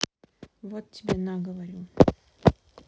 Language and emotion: Russian, sad